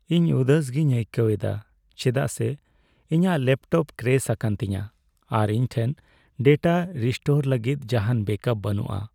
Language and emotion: Santali, sad